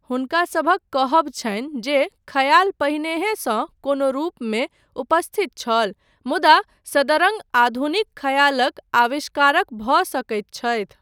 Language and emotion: Maithili, neutral